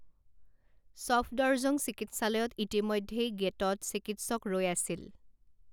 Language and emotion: Assamese, neutral